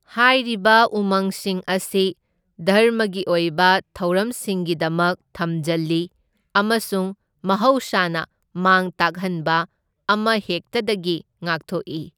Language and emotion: Manipuri, neutral